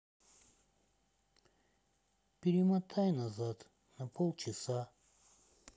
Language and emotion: Russian, sad